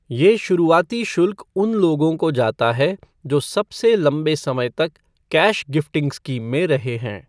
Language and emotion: Hindi, neutral